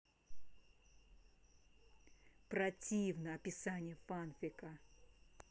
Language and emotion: Russian, angry